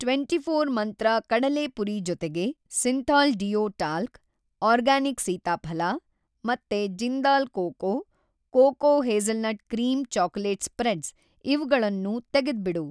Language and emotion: Kannada, neutral